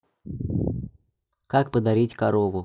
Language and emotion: Russian, neutral